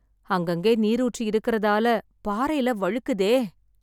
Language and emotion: Tamil, sad